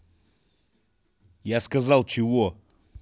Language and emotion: Russian, angry